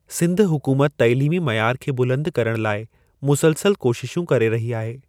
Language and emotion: Sindhi, neutral